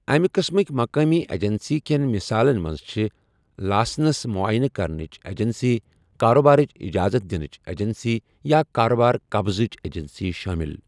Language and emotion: Kashmiri, neutral